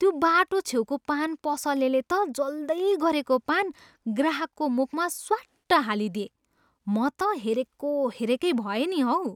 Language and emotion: Nepali, surprised